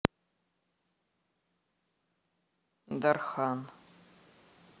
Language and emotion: Russian, neutral